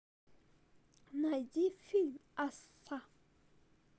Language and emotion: Russian, neutral